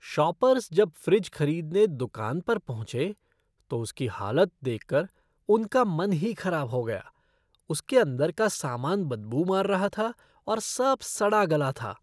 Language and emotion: Hindi, disgusted